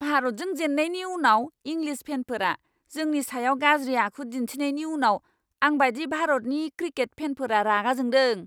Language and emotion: Bodo, angry